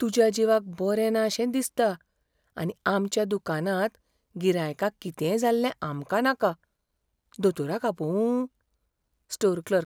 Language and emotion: Goan Konkani, fearful